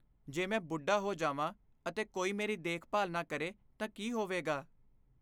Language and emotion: Punjabi, fearful